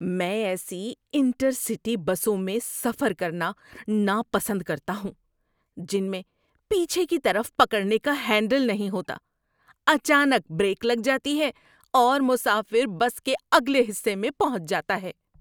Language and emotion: Urdu, disgusted